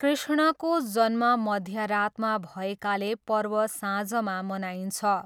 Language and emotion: Nepali, neutral